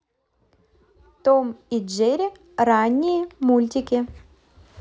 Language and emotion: Russian, positive